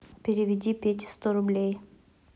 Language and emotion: Russian, neutral